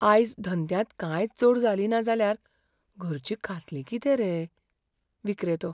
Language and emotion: Goan Konkani, fearful